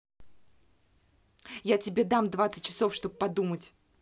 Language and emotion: Russian, angry